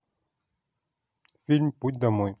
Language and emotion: Russian, neutral